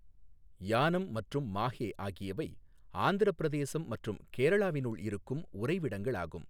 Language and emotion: Tamil, neutral